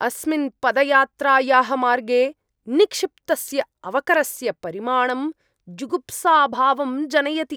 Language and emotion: Sanskrit, disgusted